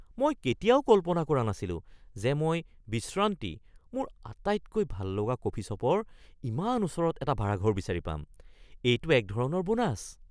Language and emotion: Assamese, surprised